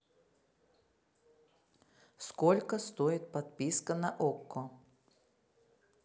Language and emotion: Russian, neutral